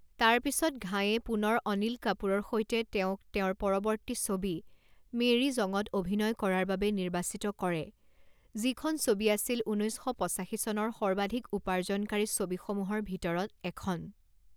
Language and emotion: Assamese, neutral